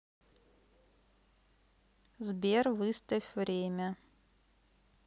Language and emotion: Russian, neutral